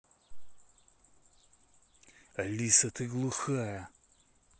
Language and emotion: Russian, angry